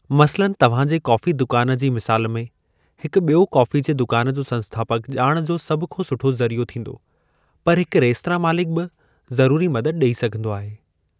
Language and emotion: Sindhi, neutral